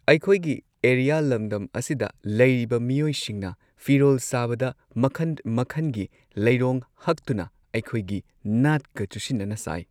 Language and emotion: Manipuri, neutral